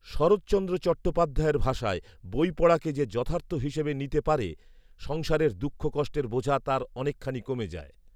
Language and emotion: Bengali, neutral